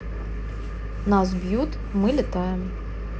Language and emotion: Russian, neutral